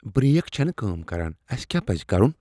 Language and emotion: Kashmiri, fearful